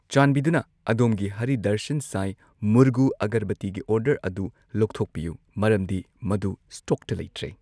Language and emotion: Manipuri, neutral